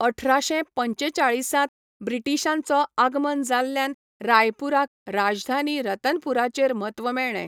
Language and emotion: Goan Konkani, neutral